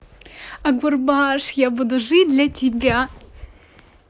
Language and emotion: Russian, positive